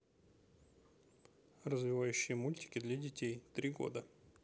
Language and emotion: Russian, neutral